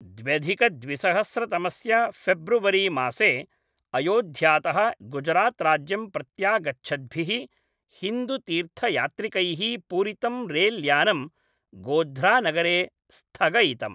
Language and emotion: Sanskrit, neutral